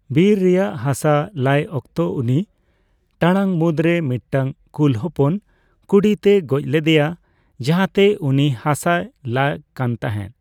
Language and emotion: Santali, neutral